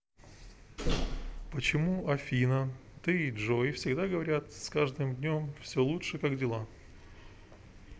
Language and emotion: Russian, neutral